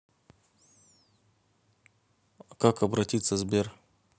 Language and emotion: Russian, neutral